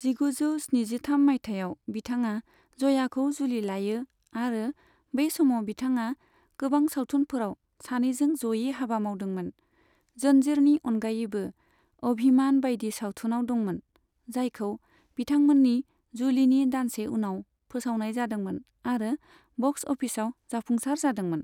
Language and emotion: Bodo, neutral